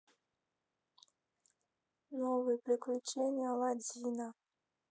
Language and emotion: Russian, sad